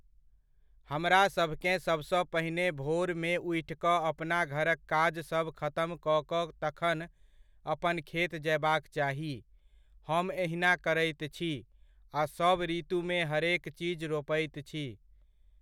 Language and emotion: Maithili, neutral